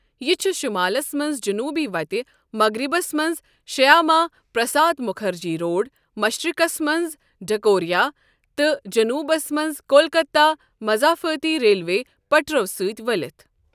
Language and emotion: Kashmiri, neutral